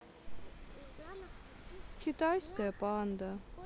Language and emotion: Russian, sad